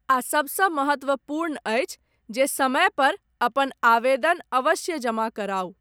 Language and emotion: Maithili, neutral